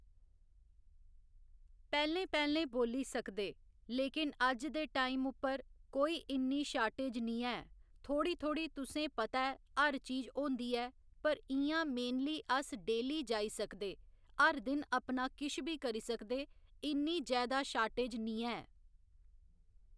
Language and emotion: Dogri, neutral